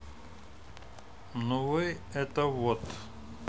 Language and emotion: Russian, neutral